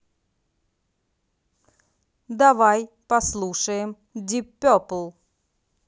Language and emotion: Russian, neutral